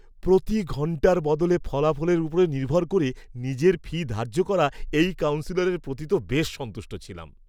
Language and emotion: Bengali, happy